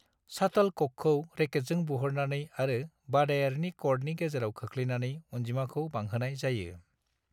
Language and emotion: Bodo, neutral